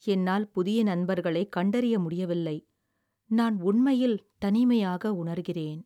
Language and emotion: Tamil, sad